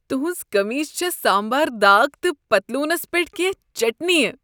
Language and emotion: Kashmiri, disgusted